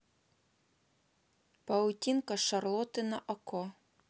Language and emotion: Russian, neutral